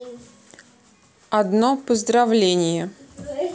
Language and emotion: Russian, neutral